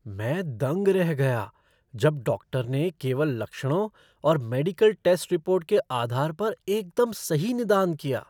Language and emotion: Hindi, surprised